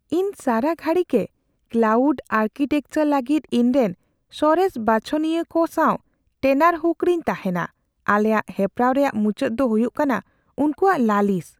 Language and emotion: Santali, fearful